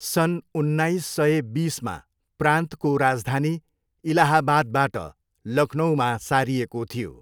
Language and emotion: Nepali, neutral